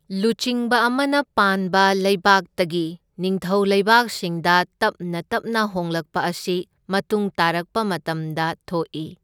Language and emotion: Manipuri, neutral